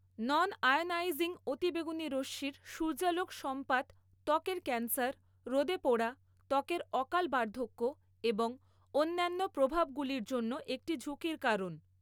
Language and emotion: Bengali, neutral